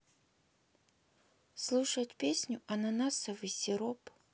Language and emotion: Russian, sad